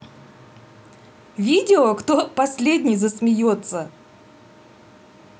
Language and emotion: Russian, positive